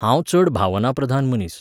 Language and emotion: Goan Konkani, neutral